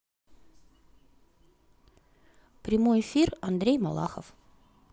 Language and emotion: Russian, positive